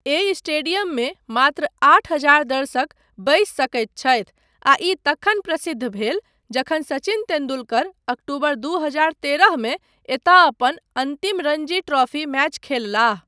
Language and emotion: Maithili, neutral